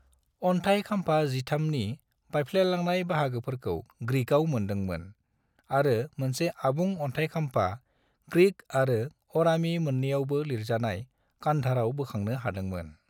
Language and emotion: Bodo, neutral